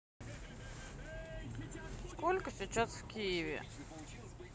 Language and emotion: Russian, neutral